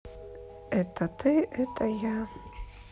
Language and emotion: Russian, sad